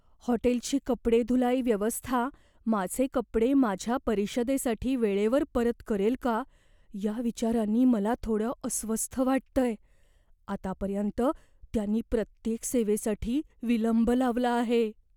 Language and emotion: Marathi, fearful